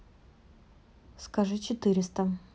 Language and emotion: Russian, neutral